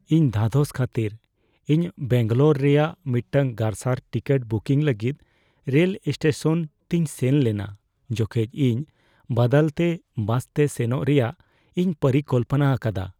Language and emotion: Santali, fearful